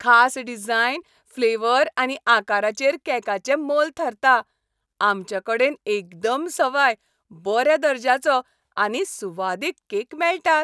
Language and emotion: Goan Konkani, happy